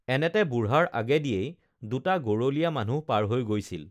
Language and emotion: Assamese, neutral